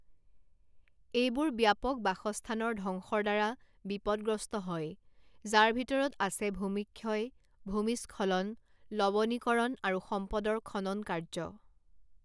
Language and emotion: Assamese, neutral